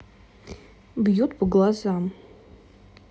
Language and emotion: Russian, neutral